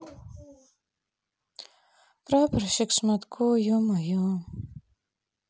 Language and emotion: Russian, sad